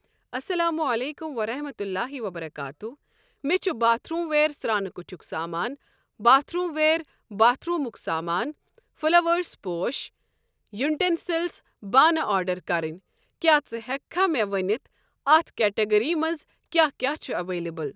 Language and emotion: Kashmiri, neutral